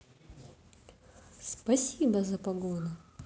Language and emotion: Russian, positive